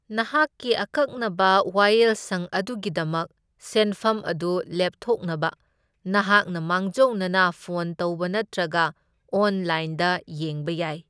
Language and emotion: Manipuri, neutral